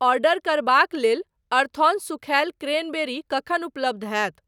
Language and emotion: Maithili, neutral